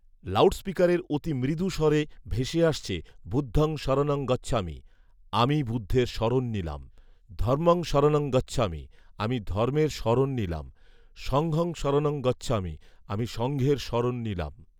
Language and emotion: Bengali, neutral